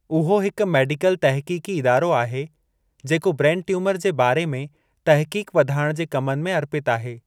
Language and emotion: Sindhi, neutral